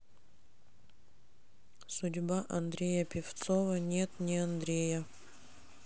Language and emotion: Russian, sad